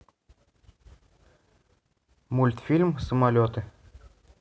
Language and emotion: Russian, neutral